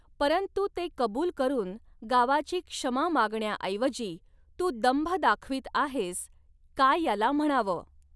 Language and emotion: Marathi, neutral